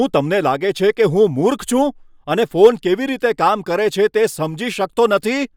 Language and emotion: Gujarati, angry